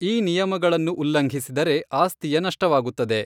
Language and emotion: Kannada, neutral